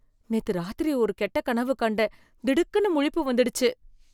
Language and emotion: Tamil, fearful